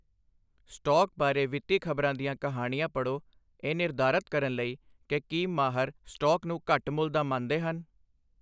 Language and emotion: Punjabi, neutral